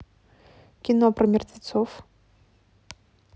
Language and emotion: Russian, neutral